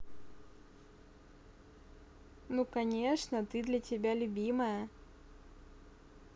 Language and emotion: Russian, neutral